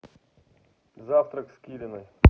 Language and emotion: Russian, neutral